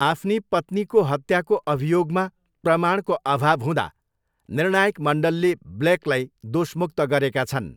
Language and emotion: Nepali, neutral